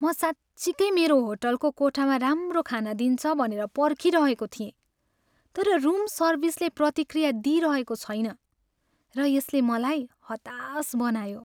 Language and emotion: Nepali, sad